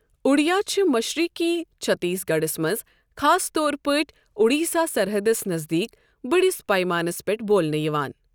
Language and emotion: Kashmiri, neutral